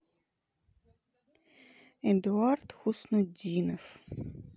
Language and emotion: Russian, neutral